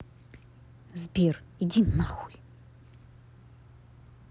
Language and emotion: Russian, angry